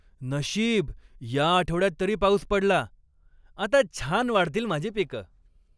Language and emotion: Marathi, happy